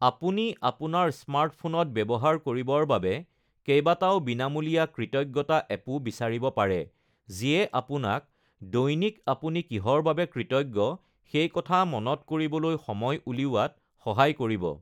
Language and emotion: Assamese, neutral